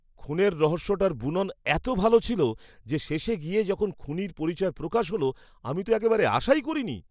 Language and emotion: Bengali, surprised